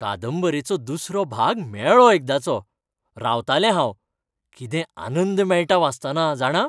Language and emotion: Goan Konkani, happy